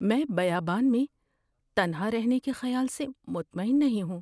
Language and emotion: Urdu, fearful